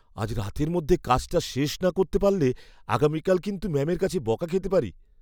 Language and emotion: Bengali, fearful